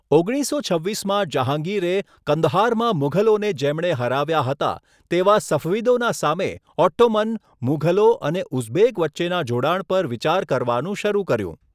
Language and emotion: Gujarati, neutral